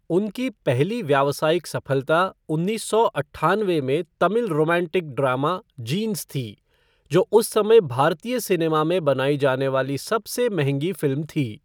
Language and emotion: Hindi, neutral